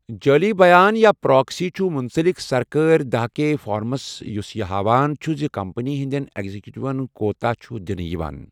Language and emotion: Kashmiri, neutral